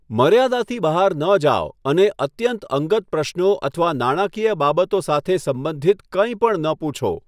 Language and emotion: Gujarati, neutral